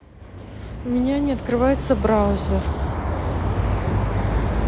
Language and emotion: Russian, neutral